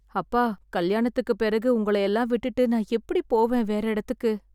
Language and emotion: Tamil, sad